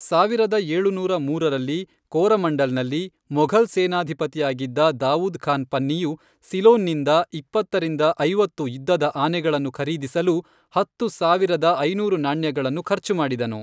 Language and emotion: Kannada, neutral